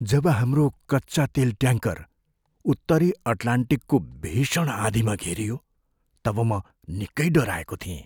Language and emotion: Nepali, fearful